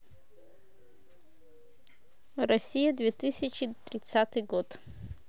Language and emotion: Russian, neutral